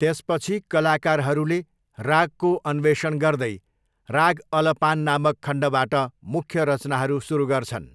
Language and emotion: Nepali, neutral